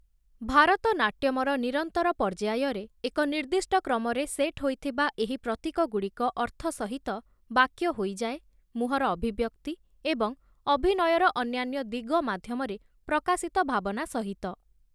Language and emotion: Odia, neutral